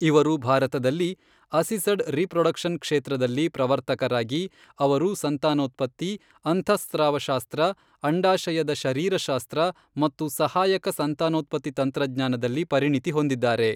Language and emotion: Kannada, neutral